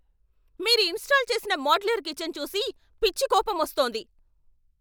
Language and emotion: Telugu, angry